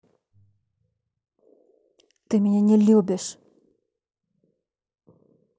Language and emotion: Russian, angry